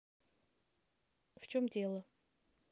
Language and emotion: Russian, neutral